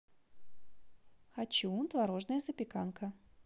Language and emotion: Russian, positive